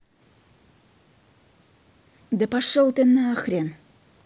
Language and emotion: Russian, angry